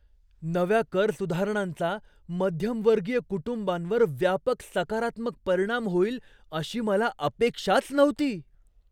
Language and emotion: Marathi, surprised